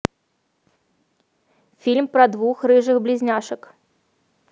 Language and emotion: Russian, neutral